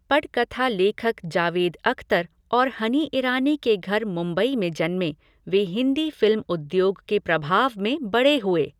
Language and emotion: Hindi, neutral